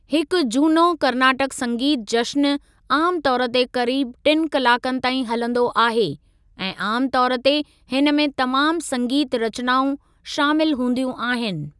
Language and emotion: Sindhi, neutral